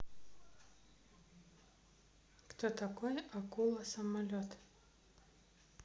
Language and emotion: Russian, neutral